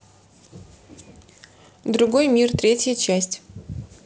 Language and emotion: Russian, neutral